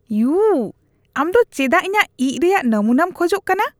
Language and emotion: Santali, disgusted